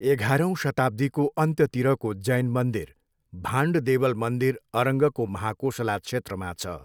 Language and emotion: Nepali, neutral